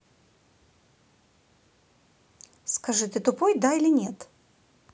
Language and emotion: Russian, angry